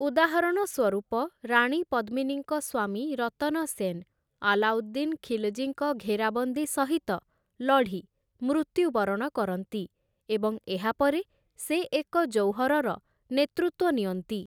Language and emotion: Odia, neutral